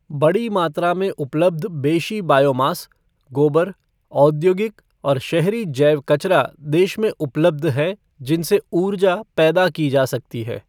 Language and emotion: Hindi, neutral